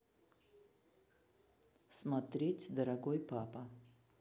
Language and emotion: Russian, neutral